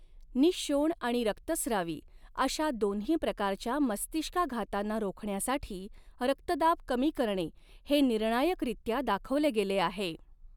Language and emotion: Marathi, neutral